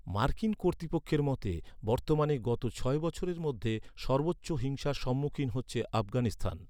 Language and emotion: Bengali, neutral